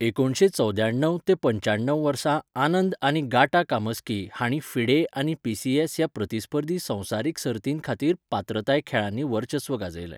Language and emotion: Goan Konkani, neutral